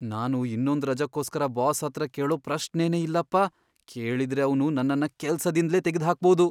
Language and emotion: Kannada, fearful